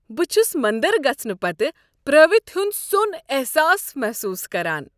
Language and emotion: Kashmiri, happy